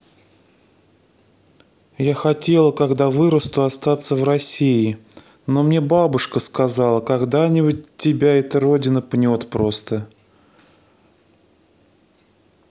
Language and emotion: Russian, sad